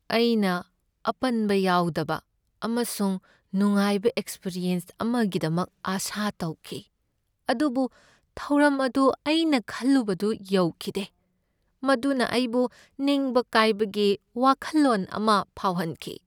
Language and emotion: Manipuri, sad